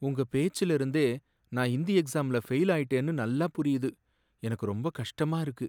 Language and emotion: Tamil, sad